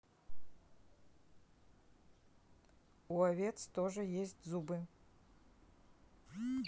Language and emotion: Russian, neutral